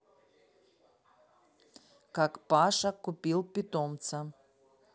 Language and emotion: Russian, neutral